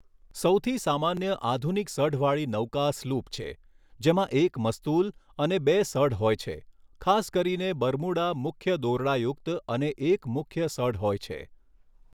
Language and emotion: Gujarati, neutral